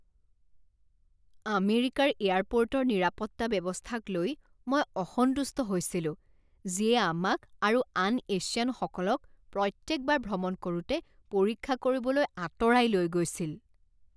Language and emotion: Assamese, disgusted